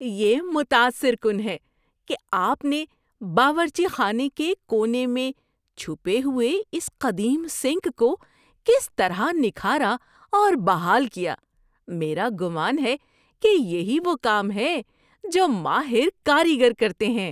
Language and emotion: Urdu, surprised